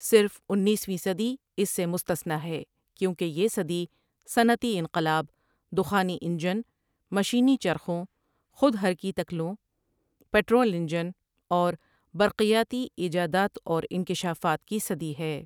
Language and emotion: Urdu, neutral